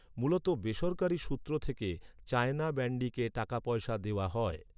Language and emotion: Bengali, neutral